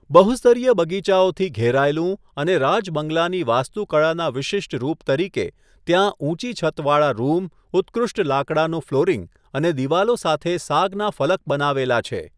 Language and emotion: Gujarati, neutral